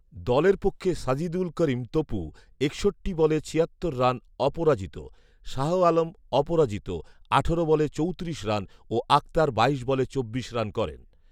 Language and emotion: Bengali, neutral